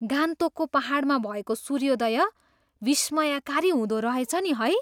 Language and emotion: Nepali, surprised